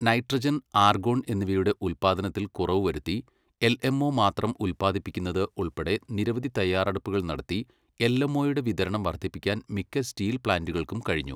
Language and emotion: Malayalam, neutral